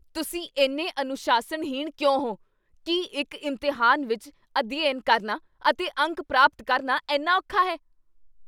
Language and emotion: Punjabi, angry